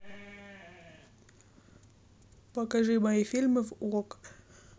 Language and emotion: Russian, neutral